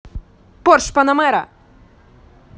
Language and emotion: Russian, angry